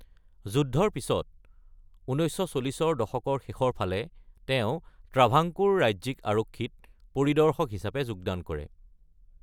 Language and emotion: Assamese, neutral